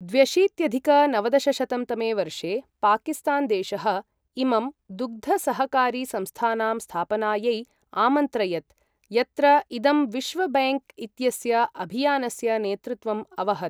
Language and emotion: Sanskrit, neutral